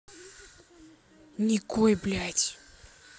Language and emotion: Russian, angry